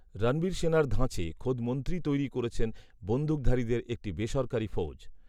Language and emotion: Bengali, neutral